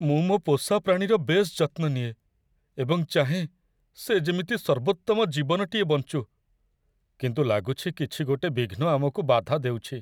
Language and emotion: Odia, sad